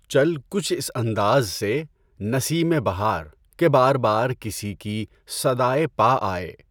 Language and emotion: Urdu, neutral